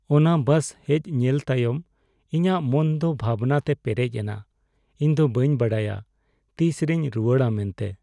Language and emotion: Santali, sad